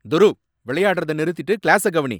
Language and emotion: Tamil, angry